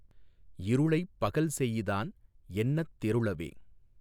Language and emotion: Tamil, neutral